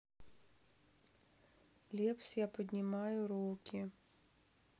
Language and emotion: Russian, sad